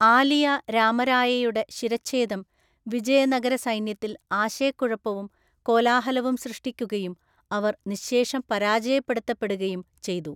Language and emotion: Malayalam, neutral